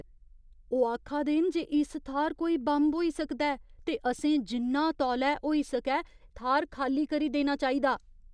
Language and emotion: Dogri, fearful